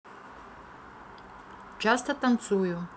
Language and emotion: Russian, neutral